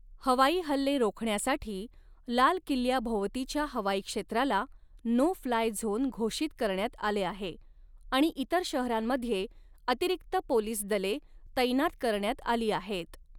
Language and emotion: Marathi, neutral